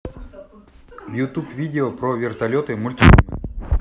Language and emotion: Russian, neutral